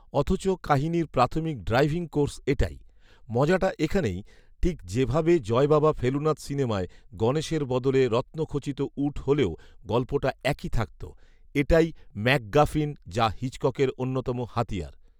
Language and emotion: Bengali, neutral